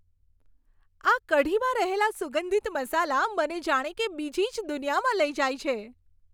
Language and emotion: Gujarati, happy